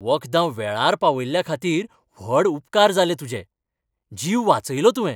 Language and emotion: Goan Konkani, happy